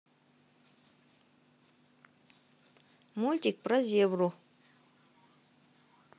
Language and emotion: Russian, neutral